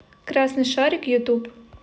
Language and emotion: Russian, neutral